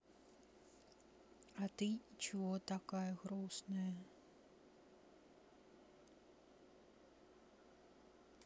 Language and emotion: Russian, sad